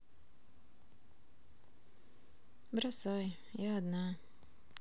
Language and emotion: Russian, sad